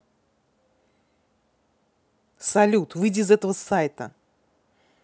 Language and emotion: Russian, angry